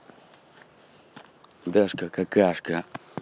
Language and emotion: Russian, neutral